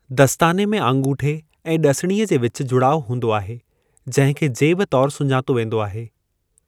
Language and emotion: Sindhi, neutral